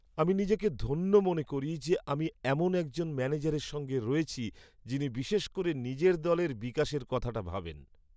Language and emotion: Bengali, happy